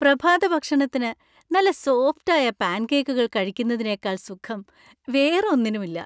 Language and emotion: Malayalam, happy